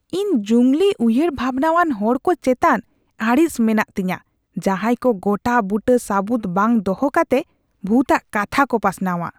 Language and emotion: Santali, disgusted